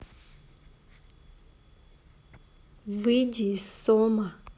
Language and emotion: Russian, neutral